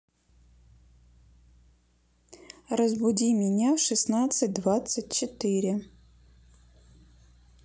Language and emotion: Russian, neutral